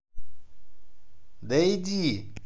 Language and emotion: Russian, angry